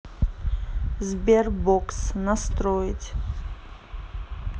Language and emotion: Russian, neutral